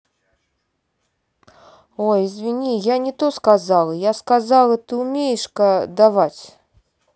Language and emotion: Russian, neutral